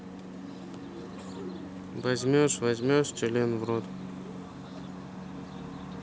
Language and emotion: Russian, neutral